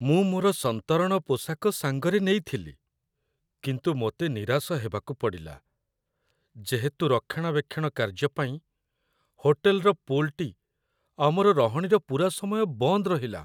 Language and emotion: Odia, sad